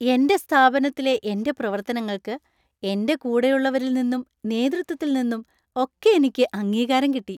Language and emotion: Malayalam, happy